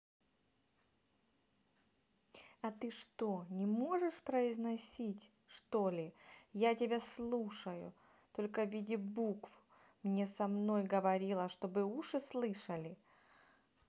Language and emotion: Russian, neutral